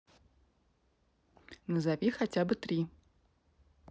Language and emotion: Russian, neutral